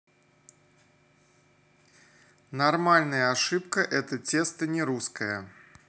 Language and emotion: Russian, neutral